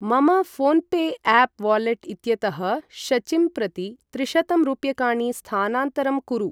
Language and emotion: Sanskrit, neutral